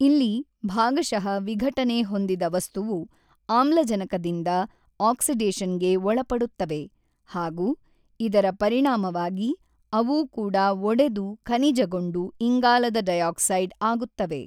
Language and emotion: Kannada, neutral